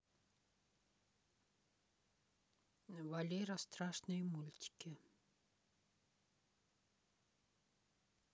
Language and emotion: Russian, neutral